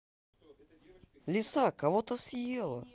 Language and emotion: Russian, positive